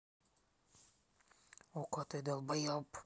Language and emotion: Russian, angry